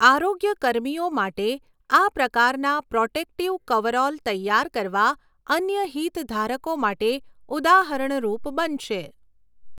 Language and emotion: Gujarati, neutral